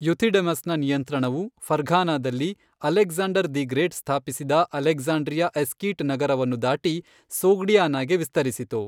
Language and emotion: Kannada, neutral